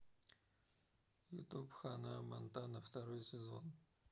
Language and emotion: Russian, neutral